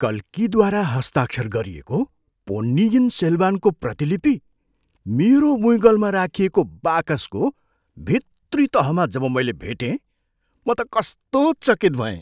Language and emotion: Nepali, surprised